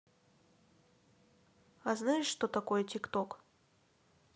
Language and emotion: Russian, neutral